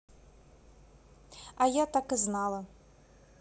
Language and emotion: Russian, sad